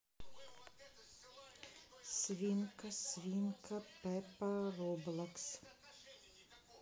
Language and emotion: Russian, neutral